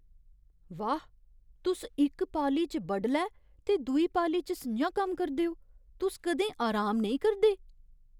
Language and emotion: Dogri, surprised